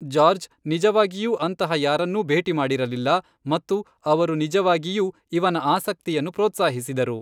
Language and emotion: Kannada, neutral